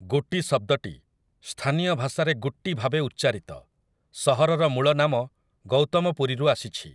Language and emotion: Odia, neutral